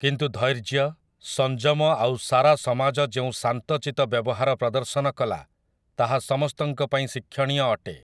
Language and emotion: Odia, neutral